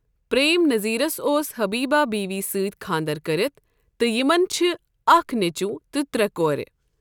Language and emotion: Kashmiri, neutral